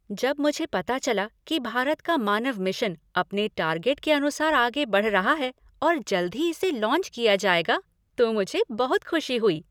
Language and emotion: Hindi, happy